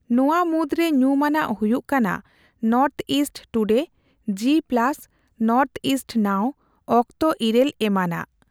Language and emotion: Santali, neutral